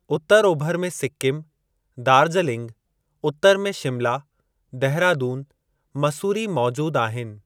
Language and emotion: Sindhi, neutral